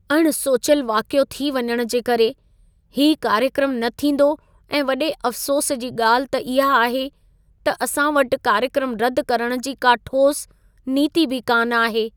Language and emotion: Sindhi, sad